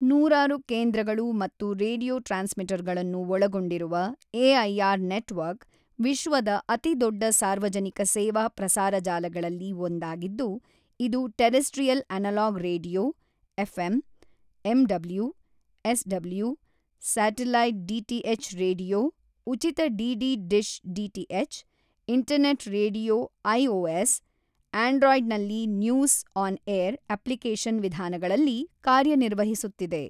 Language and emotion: Kannada, neutral